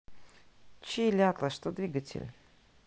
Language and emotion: Russian, neutral